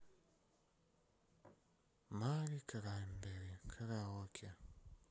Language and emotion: Russian, sad